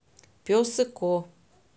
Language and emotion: Russian, neutral